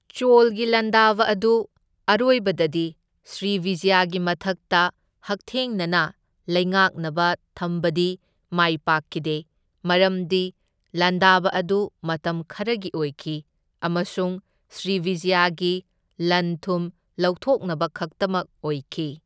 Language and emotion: Manipuri, neutral